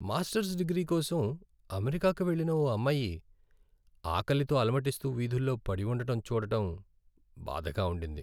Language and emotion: Telugu, sad